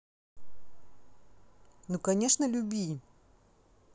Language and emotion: Russian, positive